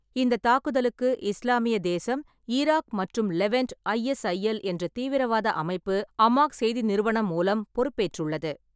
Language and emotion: Tamil, neutral